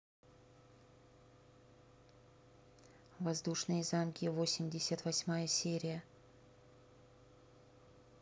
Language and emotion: Russian, neutral